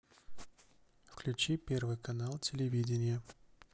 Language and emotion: Russian, neutral